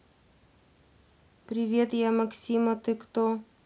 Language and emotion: Russian, neutral